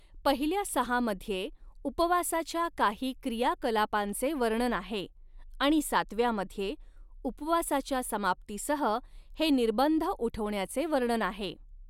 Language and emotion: Marathi, neutral